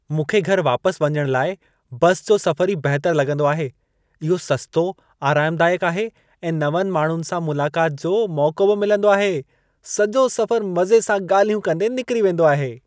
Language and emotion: Sindhi, happy